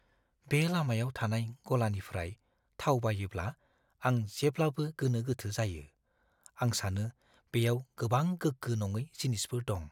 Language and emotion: Bodo, fearful